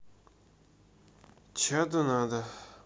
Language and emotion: Russian, neutral